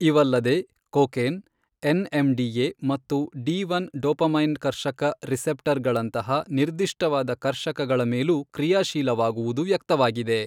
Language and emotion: Kannada, neutral